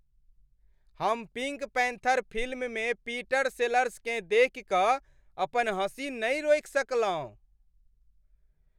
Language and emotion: Maithili, happy